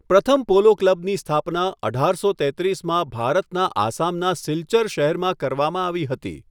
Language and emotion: Gujarati, neutral